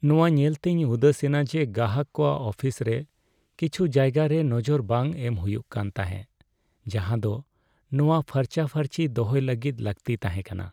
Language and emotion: Santali, sad